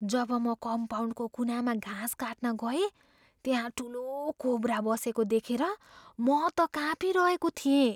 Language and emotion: Nepali, fearful